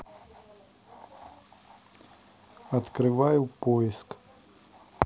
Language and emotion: Russian, neutral